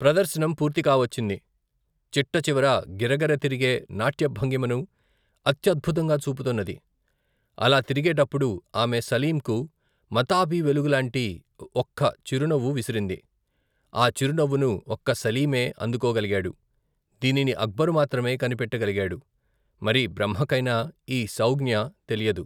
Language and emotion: Telugu, neutral